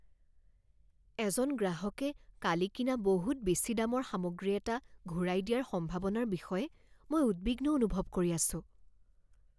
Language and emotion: Assamese, fearful